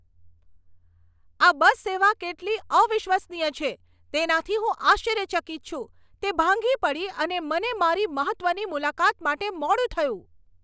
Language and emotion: Gujarati, angry